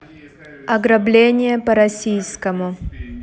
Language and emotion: Russian, neutral